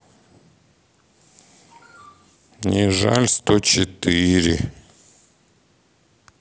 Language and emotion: Russian, sad